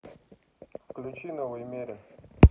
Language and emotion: Russian, neutral